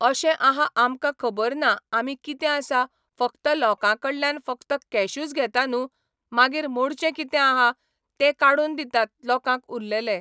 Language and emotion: Goan Konkani, neutral